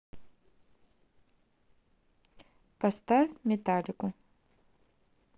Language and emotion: Russian, neutral